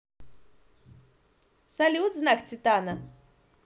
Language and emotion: Russian, positive